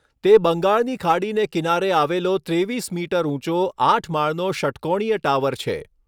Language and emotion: Gujarati, neutral